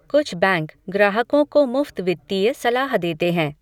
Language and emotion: Hindi, neutral